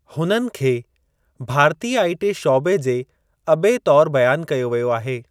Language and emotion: Sindhi, neutral